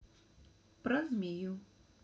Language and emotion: Russian, neutral